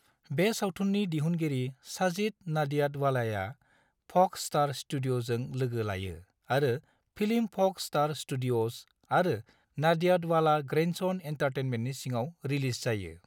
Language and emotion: Bodo, neutral